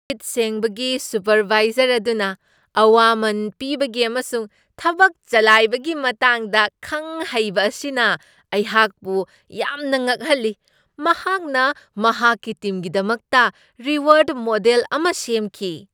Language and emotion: Manipuri, surprised